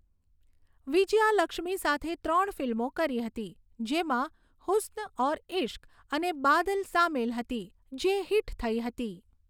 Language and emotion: Gujarati, neutral